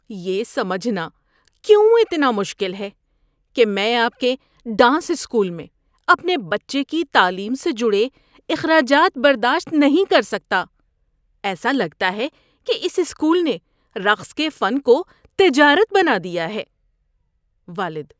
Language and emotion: Urdu, disgusted